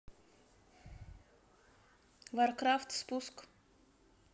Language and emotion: Russian, neutral